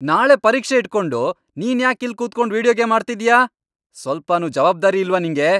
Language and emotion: Kannada, angry